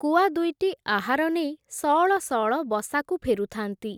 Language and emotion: Odia, neutral